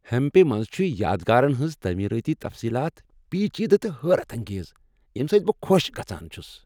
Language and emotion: Kashmiri, happy